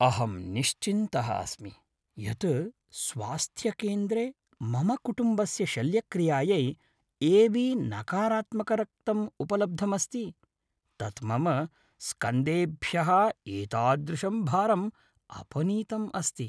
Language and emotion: Sanskrit, happy